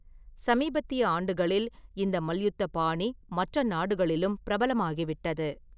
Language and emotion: Tamil, neutral